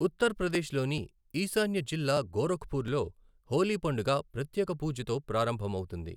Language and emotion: Telugu, neutral